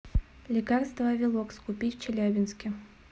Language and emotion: Russian, neutral